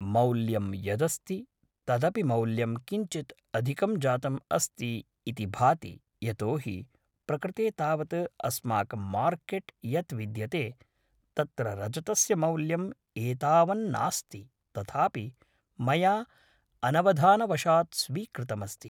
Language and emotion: Sanskrit, neutral